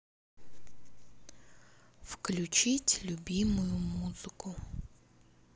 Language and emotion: Russian, neutral